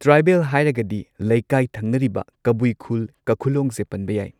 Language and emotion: Manipuri, neutral